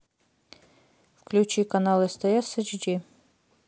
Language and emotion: Russian, neutral